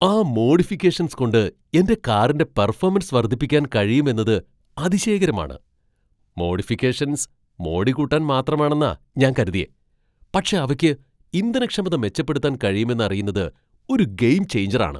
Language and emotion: Malayalam, surprised